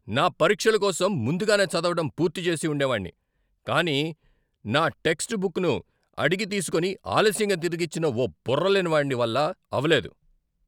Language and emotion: Telugu, angry